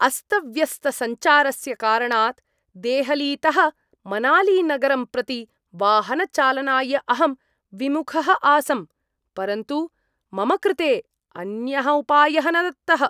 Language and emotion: Sanskrit, disgusted